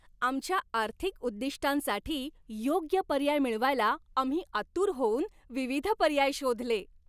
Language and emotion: Marathi, happy